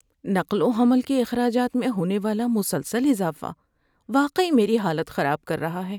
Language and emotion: Urdu, sad